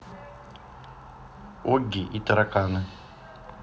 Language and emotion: Russian, neutral